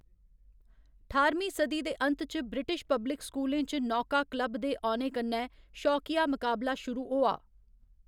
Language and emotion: Dogri, neutral